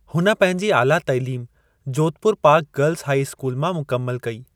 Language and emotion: Sindhi, neutral